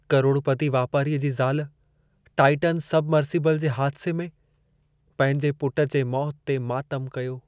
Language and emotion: Sindhi, sad